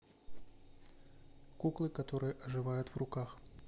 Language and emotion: Russian, neutral